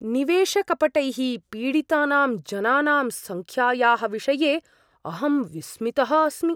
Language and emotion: Sanskrit, surprised